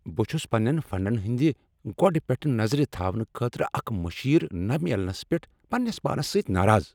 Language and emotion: Kashmiri, angry